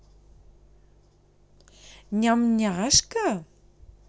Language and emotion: Russian, positive